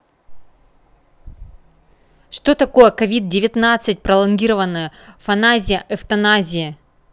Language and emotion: Russian, neutral